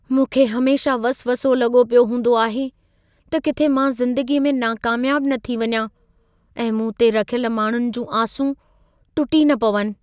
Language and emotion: Sindhi, fearful